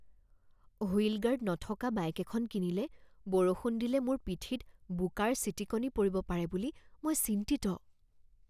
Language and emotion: Assamese, fearful